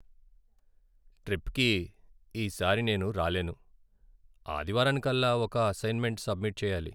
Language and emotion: Telugu, sad